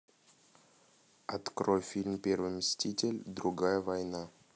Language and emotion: Russian, neutral